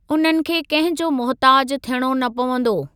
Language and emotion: Sindhi, neutral